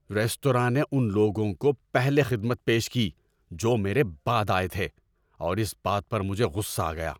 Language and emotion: Urdu, angry